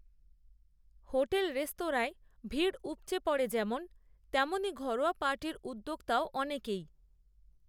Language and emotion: Bengali, neutral